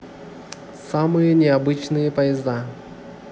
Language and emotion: Russian, neutral